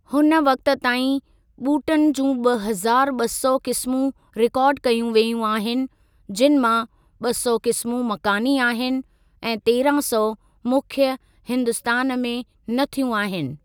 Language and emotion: Sindhi, neutral